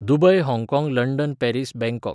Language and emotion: Goan Konkani, neutral